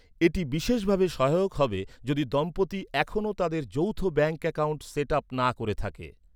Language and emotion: Bengali, neutral